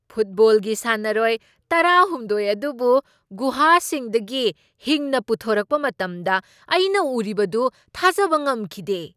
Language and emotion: Manipuri, surprised